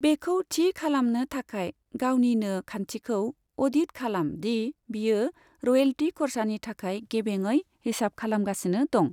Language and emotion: Bodo, neutral